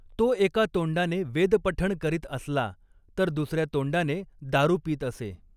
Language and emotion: Marathi, neutral